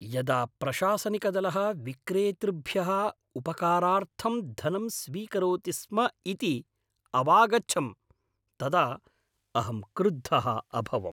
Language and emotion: Sanskrit, angry